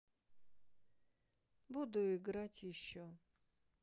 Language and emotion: Russian, neutral